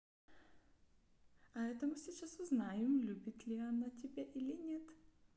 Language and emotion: Russian, neutral